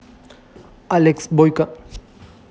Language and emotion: Russian, positive